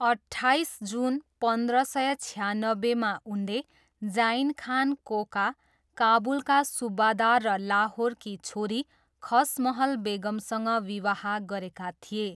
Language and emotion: Nepali, neutral